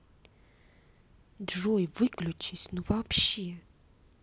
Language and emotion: Russian, angry